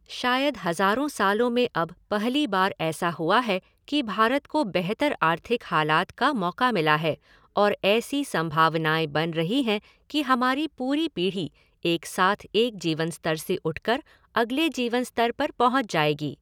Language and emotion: Hindi, neutral